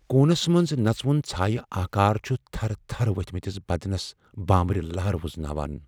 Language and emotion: Kashmiri, fearful